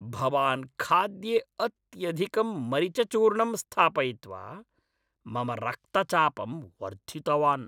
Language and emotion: Sanskrit, angry